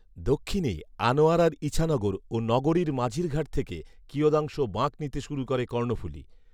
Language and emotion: Bengali, neutral